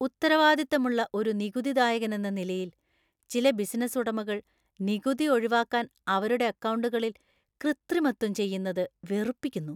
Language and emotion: Malayalam, disgusted